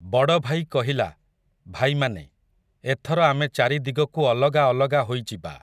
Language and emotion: Odia, neutral